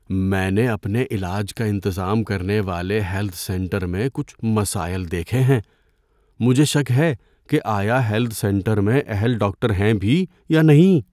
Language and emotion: Urdu, fearful